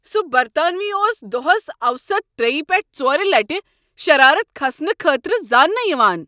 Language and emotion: Kashmiri, angry